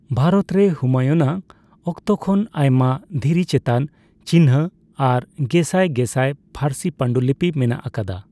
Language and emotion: Santali, neutral